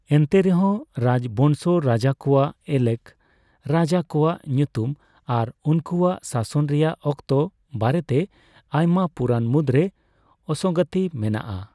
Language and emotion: Santali, neutral